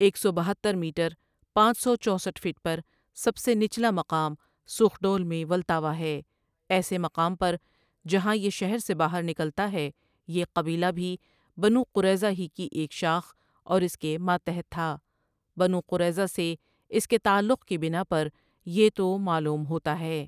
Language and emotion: Urdu, neutral